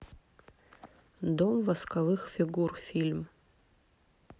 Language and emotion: Russian, neutral